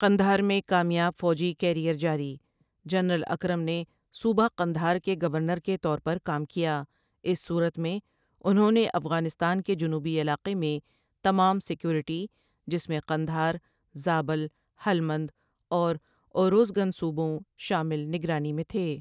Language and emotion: Urdu, neutral